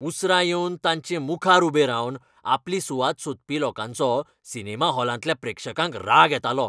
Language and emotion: Goan Konkani, angry